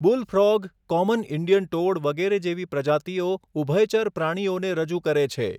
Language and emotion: Gujarati, neutral